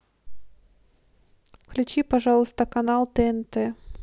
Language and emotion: Russian, neutral